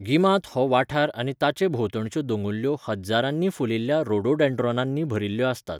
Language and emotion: Goan Konkani, neutral